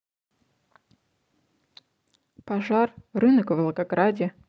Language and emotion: Russian, neutral